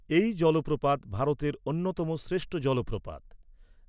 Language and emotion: Bengali, neutral